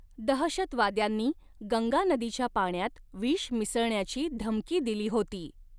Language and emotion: Marathi, neutral